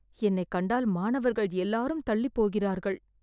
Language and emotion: Tamil, sad